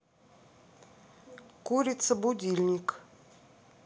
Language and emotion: Russian, neutral